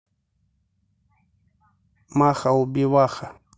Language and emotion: Russian, neutral